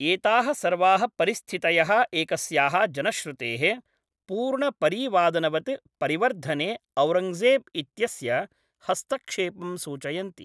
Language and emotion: Sanskrit, neutral